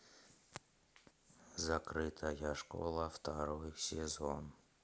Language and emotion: Russian, neutral